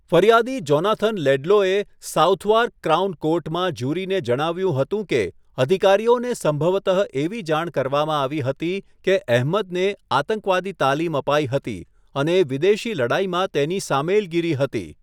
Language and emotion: Gujarati, neutral